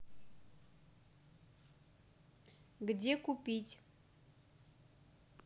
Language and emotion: Russian, neutral